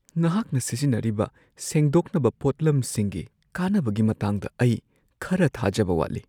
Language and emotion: Manipuri, fearful